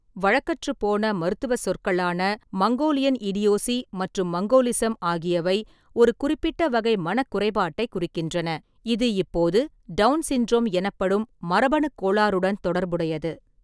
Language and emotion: Tamil, neutral